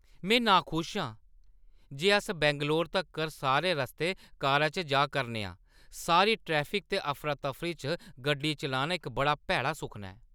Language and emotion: Dogri, angry